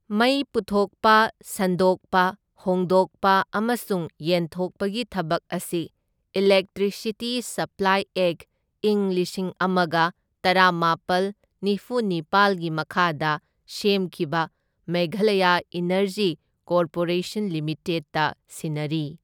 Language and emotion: Manipuri, neutral